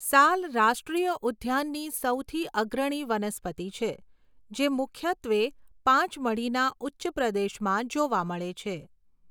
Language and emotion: Gujarati, neutral